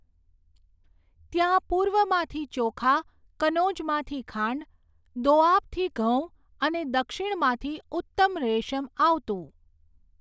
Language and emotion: Gujarati, neutral